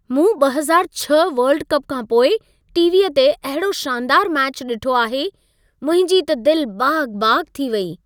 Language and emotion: Sindhi, happy